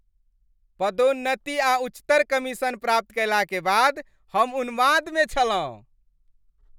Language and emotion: Maithili, happy